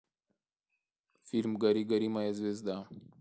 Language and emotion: Russian, neutral